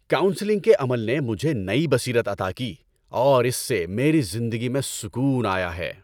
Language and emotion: Urdu, happy